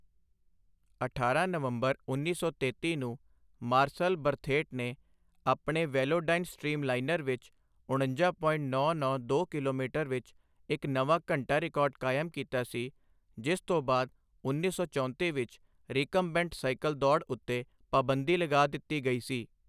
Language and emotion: Punjabi, neutral